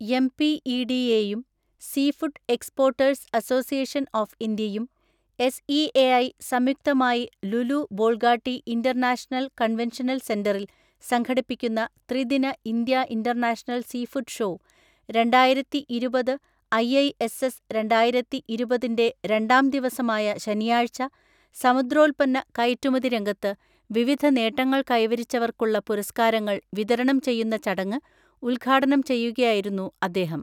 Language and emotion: Malayalam, neutral